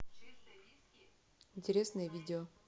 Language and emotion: Russian, neutral